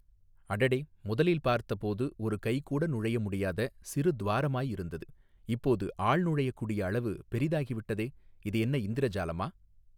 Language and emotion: Tamil, neutral